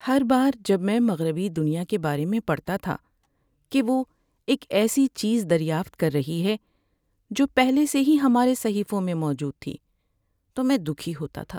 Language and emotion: Urdu, sad